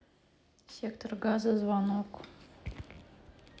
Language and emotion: Russian, neutral